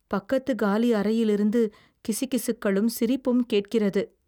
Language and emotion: Tamil, fearful